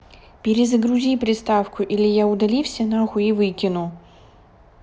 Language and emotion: Russian, angry